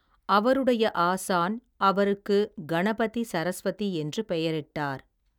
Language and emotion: Tamil, neutral